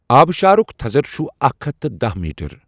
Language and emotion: Kashmiri, neutral